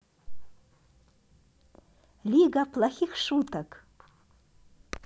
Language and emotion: Russian, positive